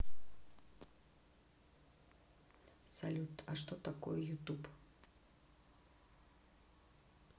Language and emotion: Russian, neutral